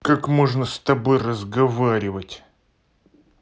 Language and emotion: Russian, angry